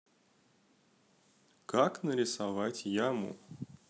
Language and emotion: Russian, positive